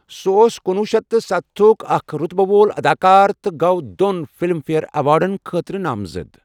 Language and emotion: Kashmiri, neutral